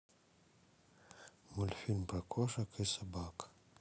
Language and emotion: Russian, sad